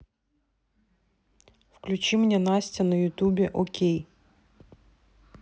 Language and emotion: Russian, neutral